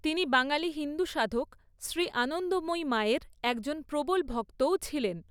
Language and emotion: Bengali, neutral